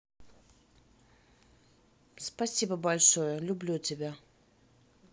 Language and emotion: Russian, neutral